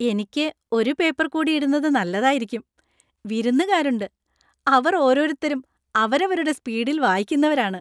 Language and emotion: Malayalam, happy